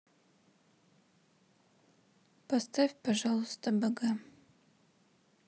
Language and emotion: Russian, sad